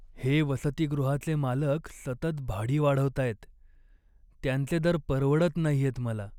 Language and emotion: Marathi, sad